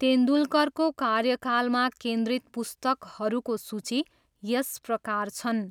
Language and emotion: Nepali, neutral